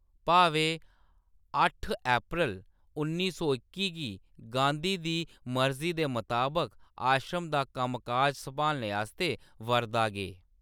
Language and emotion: Dogri, neutral